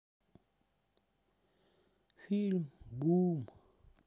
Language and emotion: Russian, sad